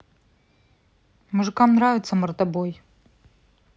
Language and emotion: Russian, neutral